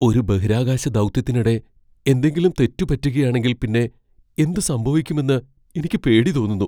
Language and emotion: Malayalam, fearful